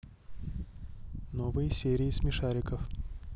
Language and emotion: Russian, neutral